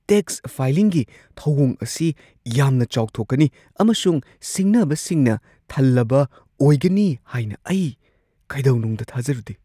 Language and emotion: Manipuri, surprised